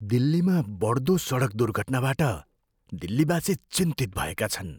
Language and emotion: Nepali, fearful